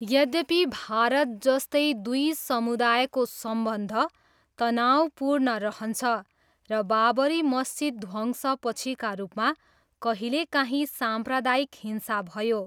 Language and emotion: Nepali, neutral